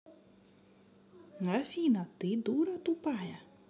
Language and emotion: Russian, positive